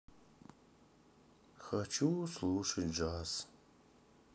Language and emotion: Russian, sad